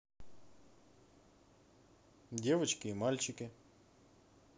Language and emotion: Russian, neutral